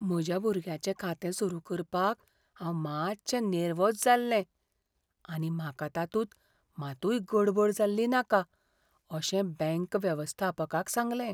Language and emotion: Goan Konkani, fearful